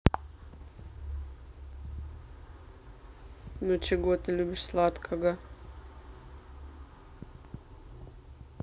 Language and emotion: Russian, neutral